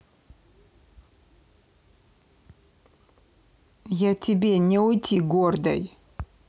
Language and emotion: Russian, angry